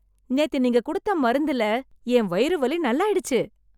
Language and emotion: Tamil, happy